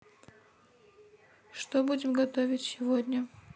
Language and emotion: Russian, neutral